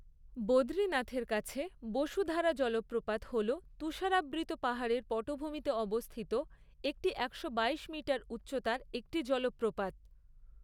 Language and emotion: Bengali, neutral